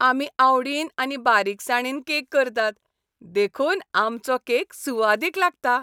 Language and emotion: Goan Konkani, happy